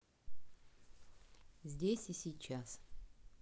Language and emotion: Russian, neutral